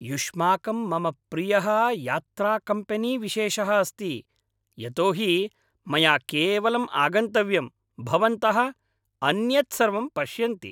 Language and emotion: Sanskrit, happy